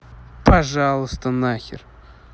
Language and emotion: Russian, angry